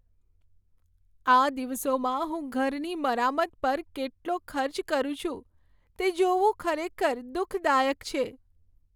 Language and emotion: Gujarati, sad